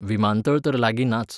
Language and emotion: Goan Konkani, neutral